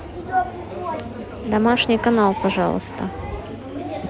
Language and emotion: Russian, neutral